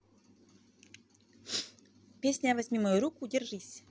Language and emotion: Russian, neutral